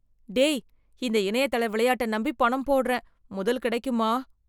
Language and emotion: Tamil, fearful